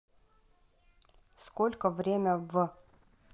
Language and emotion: Russian, neutral